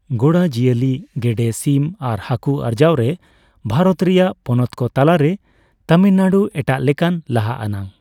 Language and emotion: Santali, neutral